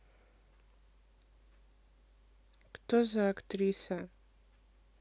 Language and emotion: Russian, neutral